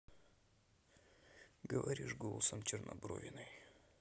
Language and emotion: Russian, neutral